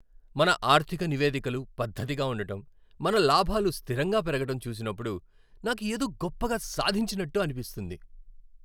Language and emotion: Telugu, happy